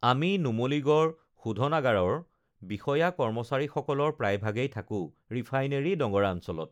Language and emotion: Assamese, neutral